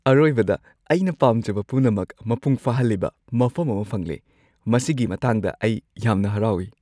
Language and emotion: Manipuri, happy